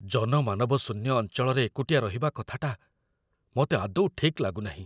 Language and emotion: Odia, fearful